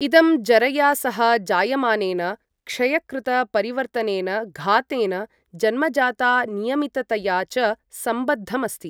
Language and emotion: Sanskrit, neutral